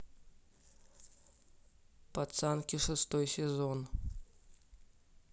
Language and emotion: Russian, neutral